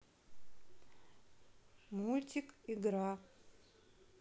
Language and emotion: Russian, neutral